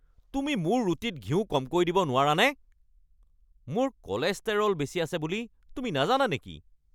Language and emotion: Assamese, angry